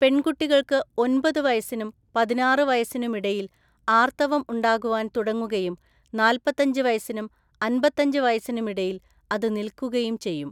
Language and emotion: Malayalam, neutral